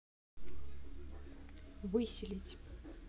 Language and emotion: Russian, neutral